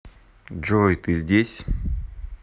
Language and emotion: Russian, neutral